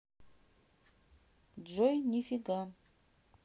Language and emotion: Russian, neutral